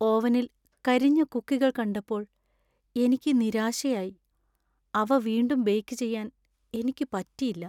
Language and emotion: Malayalam, sad